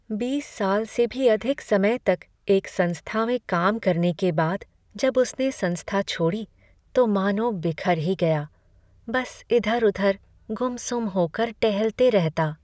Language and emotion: Hindi, sad